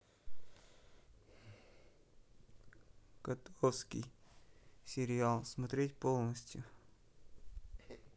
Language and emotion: Russian, neutral